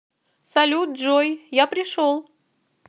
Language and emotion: Russian, positive